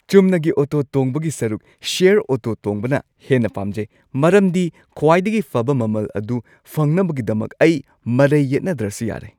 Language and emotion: Manipuri, happy